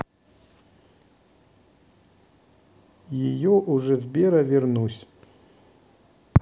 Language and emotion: Russian, neutral